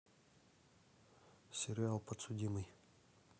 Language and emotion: Russian, neutral